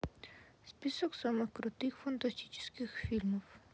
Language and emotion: Russian, sad